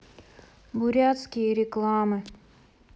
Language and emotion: Russian, sad